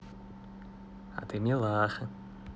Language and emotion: Russian, positive